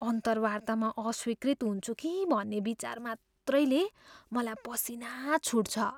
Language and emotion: Nepali, fearful